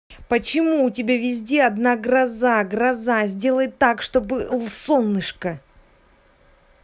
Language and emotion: Russian, angry